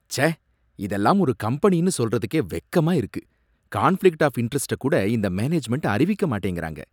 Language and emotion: Tamil, disgusted